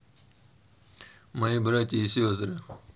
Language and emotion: Russian, neutral